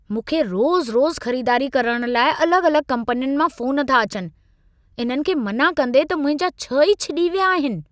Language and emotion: Sindhi, angry